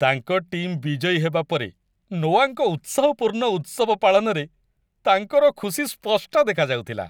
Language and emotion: Odia, happy